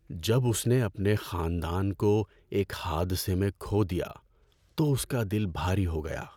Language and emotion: Urdu, sad